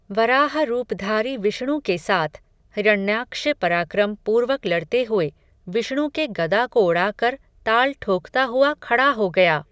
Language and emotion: Hindi, neutral